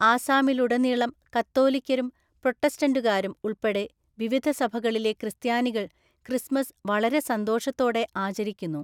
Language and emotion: Malayalam, neutral